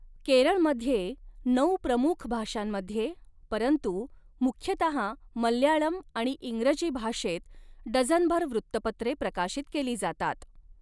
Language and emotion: Marathi, neutral